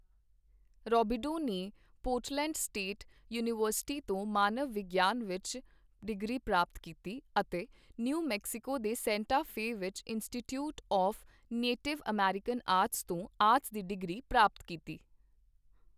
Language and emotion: Punjabi, neutral